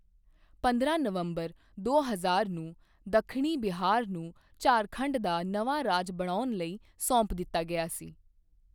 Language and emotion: Punjabi, neutral